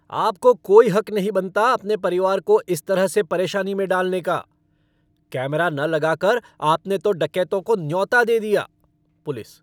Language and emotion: Hindi, angry